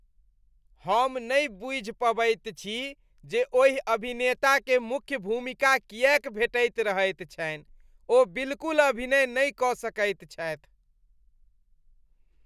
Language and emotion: Maithili, disgusted